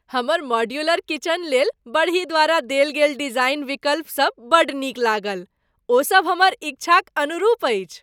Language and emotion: Maithili, happy